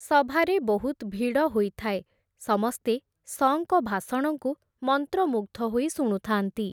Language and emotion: Odia, neutral